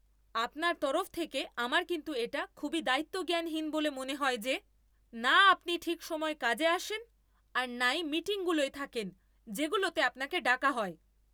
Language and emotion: Bengali, angry